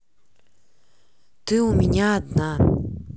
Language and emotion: Russian, neutral